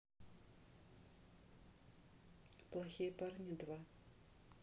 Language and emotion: Russian, neutral